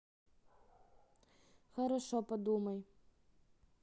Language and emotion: Russian, neutral